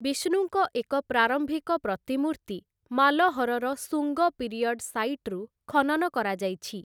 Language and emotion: Odia, neutral